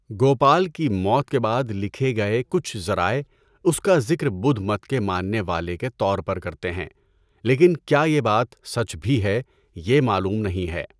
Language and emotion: Urdu, neutral